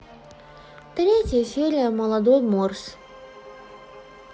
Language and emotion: Russian, sad